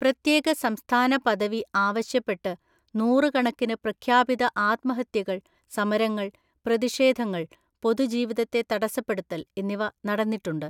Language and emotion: Malayalam, neutral